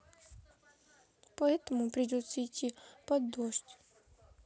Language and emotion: Russian, sad